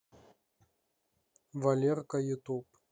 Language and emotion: Russian, neutral